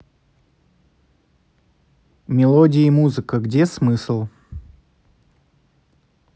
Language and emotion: Russian, neutral